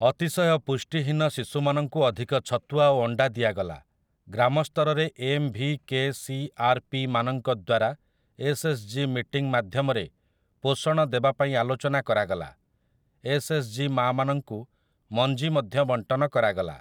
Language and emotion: Odia, neutral